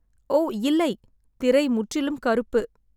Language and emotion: Tamil, sad